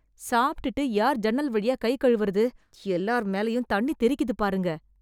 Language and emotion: Tamil, disgusted